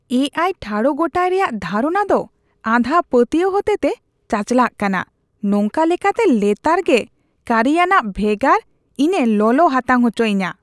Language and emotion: Santali, disgusted